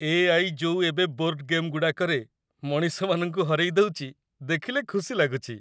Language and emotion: Odia, happy